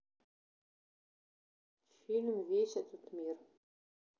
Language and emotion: Russian, neutral